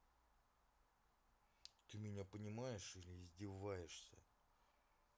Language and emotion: Russian, angry